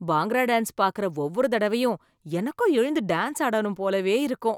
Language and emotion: Tamil, happy